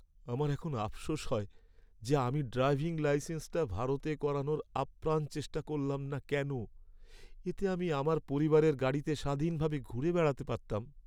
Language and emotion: Bengali, sad